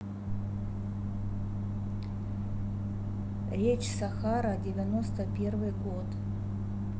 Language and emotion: Russian, neutral